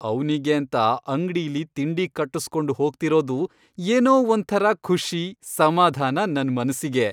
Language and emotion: Kannada, happy